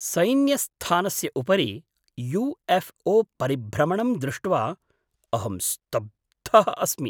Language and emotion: Sanskrit, surprised